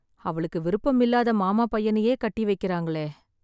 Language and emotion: Tamil, sad